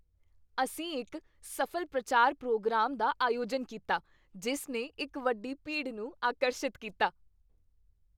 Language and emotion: Punjabi, happy